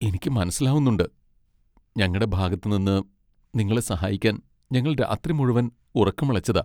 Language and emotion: Malayalam, sad